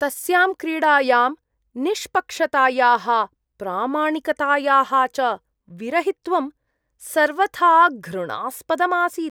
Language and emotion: Sanskrit, disgusted